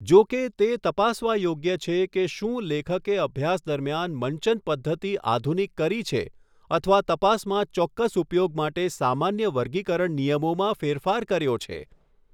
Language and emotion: Gujarati, neutral